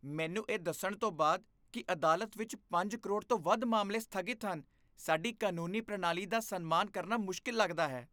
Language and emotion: Punjabi, disgusted